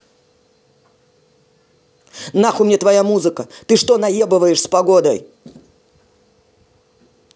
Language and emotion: Russian, angry